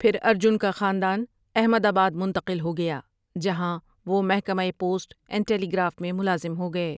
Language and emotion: Urdu, neutral